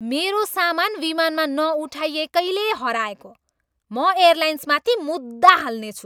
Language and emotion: Nepali, angry